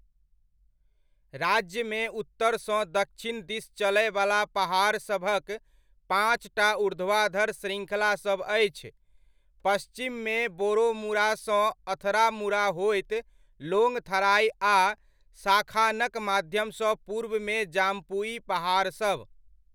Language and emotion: Maithili, neutral